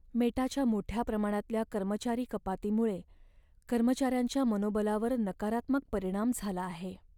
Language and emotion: Marathi, sad